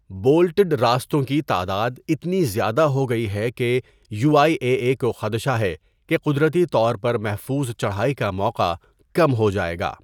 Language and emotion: Urdu, neutral